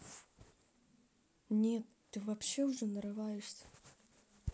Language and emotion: Russian, sad